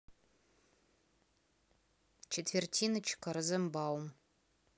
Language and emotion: Russian, neutral